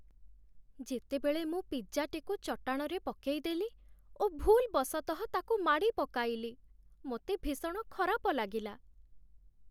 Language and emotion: Odia, sad